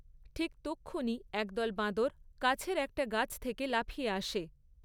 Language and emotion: Bengali, neutral